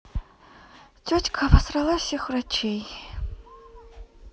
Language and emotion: Russian, sad